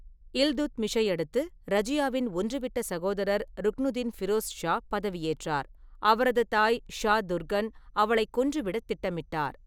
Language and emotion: Tamil, neutral